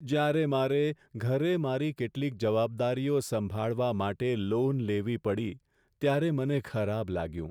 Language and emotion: Gujarati, sad